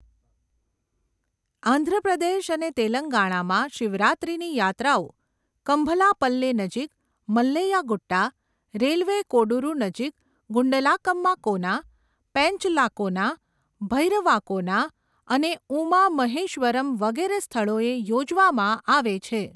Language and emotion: Gujarati, neutral